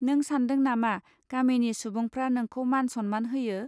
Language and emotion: Bodo, neutral